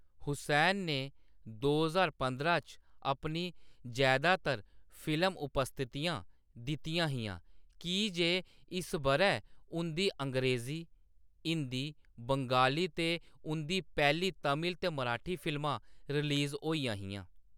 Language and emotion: Dogri, neutral